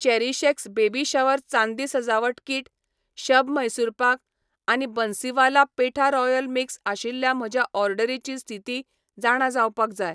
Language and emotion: Goan Konkani, neutral